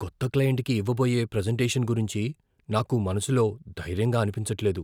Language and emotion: Telugu, fearful